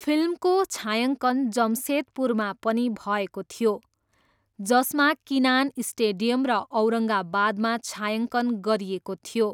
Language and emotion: Nepali, neutral